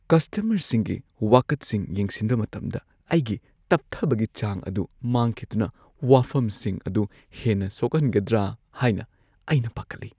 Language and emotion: Manipuri, fearful